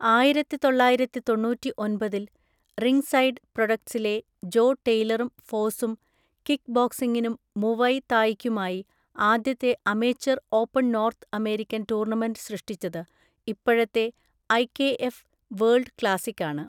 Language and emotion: Malayalam, neutral